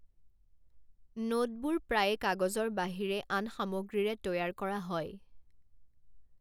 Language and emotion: Assamese, neutral